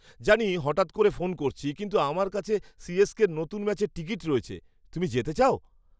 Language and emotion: Bengali, surprised